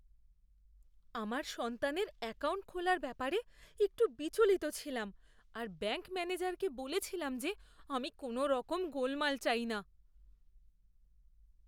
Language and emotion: Bengali, fearful